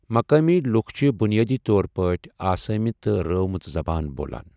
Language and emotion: Kashmiri, neutral